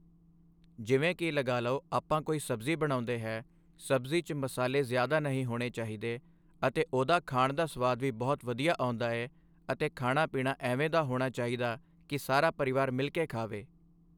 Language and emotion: Punjabi, neutral